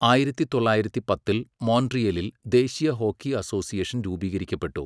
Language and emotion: Malayalam, neutral